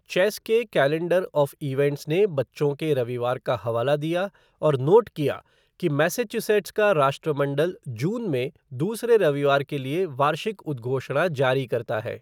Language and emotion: Hindi, neutral